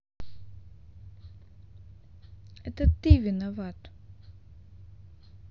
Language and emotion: Russian, sad